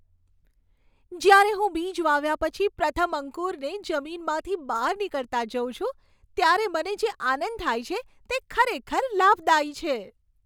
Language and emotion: Gujarati, happy